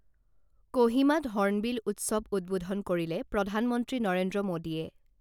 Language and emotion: Assamese, neutral